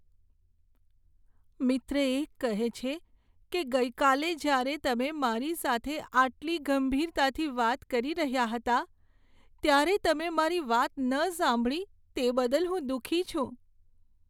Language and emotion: Gujarati, sad